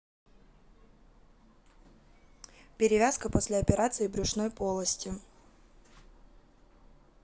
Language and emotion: Russian, neutral